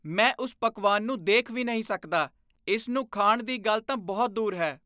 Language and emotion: Punjabi, disgusted